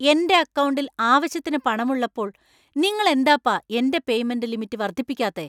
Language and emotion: Malayalam, angry